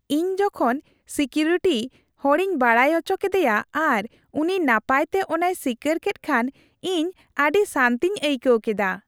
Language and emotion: Santali, happy